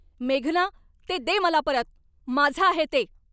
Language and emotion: Marathi, angry